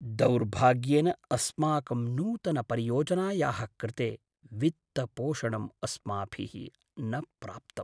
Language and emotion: Sanskrit, sad